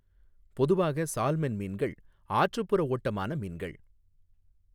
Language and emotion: Tamil, neutral